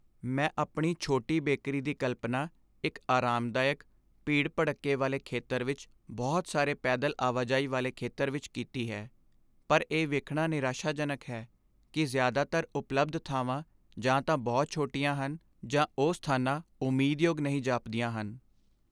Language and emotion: Punjabi, sad